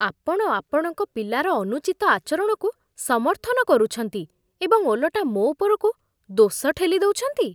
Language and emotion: Odia, disgusted